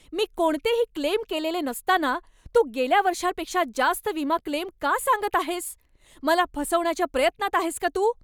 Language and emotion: Marathi, angry